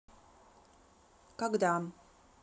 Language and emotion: Russian, neutral